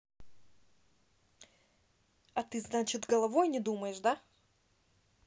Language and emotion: Russian, angry